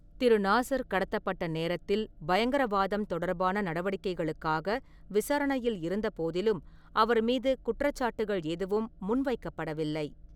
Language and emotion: Tamil, neutral